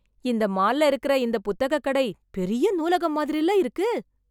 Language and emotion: Tamil, surprised